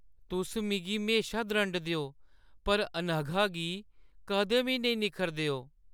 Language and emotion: Dogri, sad